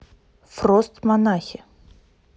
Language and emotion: Russian, neutral